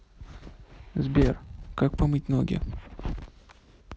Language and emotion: Russian, neutral